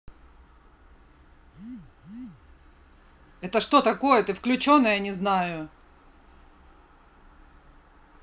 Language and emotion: Russian, angry